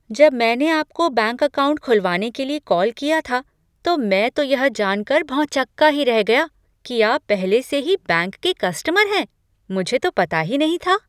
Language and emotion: Hindi, surprised